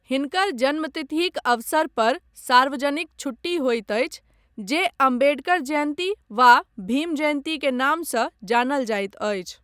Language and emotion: Maithili, neutral